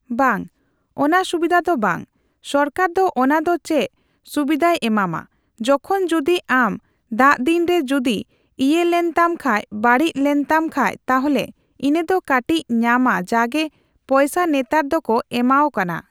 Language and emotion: Santali, neutral